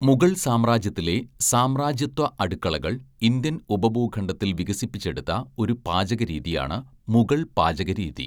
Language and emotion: Malayalam, neutral